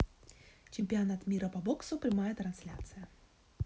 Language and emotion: Russian, neutral